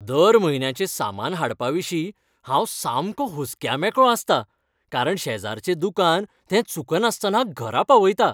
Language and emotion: Goan Konkani, happy